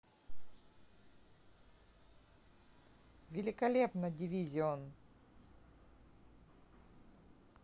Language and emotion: Russian, positive